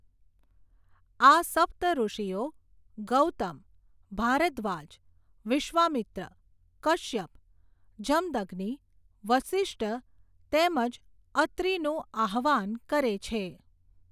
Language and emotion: Gujarati, neutral